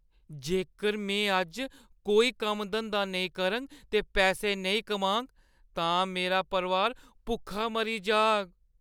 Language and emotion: Dogri, fearful